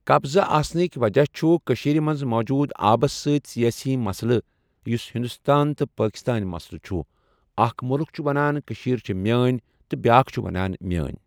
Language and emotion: Kashmiri, neutral